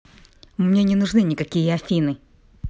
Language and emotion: Russian, angry